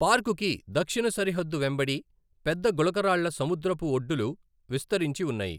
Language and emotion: Telugu, neutral